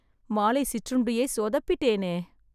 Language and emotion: Tamil, sad